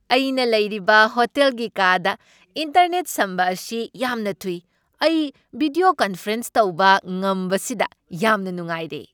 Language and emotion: Manipuri, happy